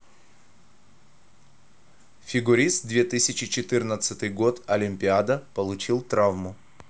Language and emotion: Russian, neutral